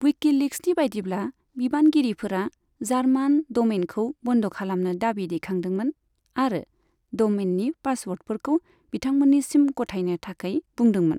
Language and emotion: Bodo, neutral